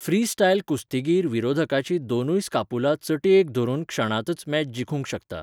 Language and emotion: Goan Konkani, neutral